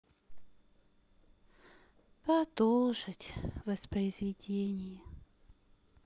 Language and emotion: Russian, sad